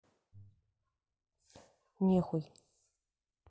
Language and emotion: Russian, neutral